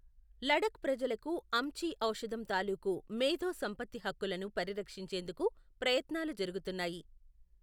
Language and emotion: Telugu, neutral